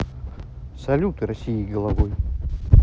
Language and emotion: Russian, neutral